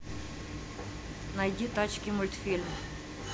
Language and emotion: Russian, neutral